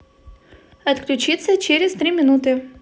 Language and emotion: Russian, positive